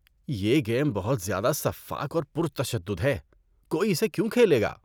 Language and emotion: Urdu, disgusted